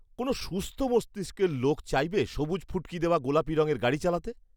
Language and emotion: Bengali, disgusted